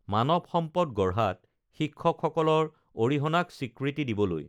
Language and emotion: Assamese, neutral